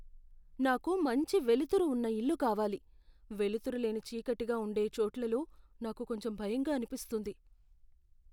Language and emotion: Telugu, fearful